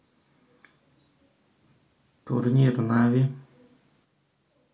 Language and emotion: Russian, neutral